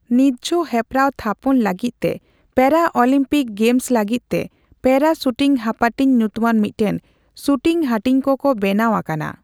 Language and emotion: Santali, neutral